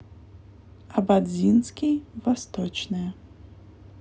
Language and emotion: Russian, neutral